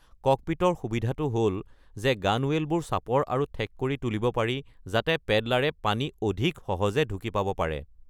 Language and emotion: Assamese, neutral